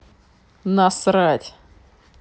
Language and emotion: Russian, angry